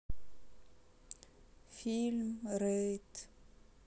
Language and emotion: Russian, sad